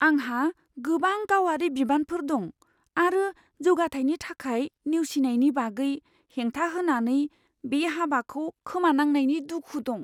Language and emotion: Bodo, fearful